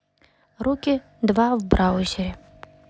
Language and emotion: Russian, neutral